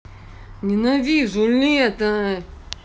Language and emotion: Russian, angry